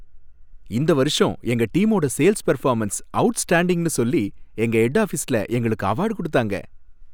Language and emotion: Tamil, happy